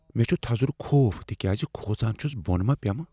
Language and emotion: Kashmiri, fearful